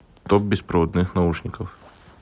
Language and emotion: Russian, neutral